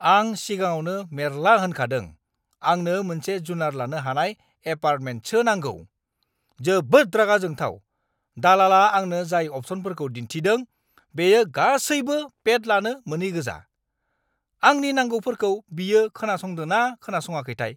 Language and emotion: Bodo, angry